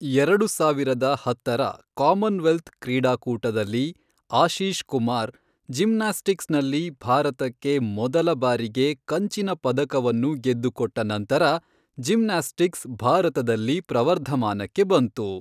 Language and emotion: Kannada, neutral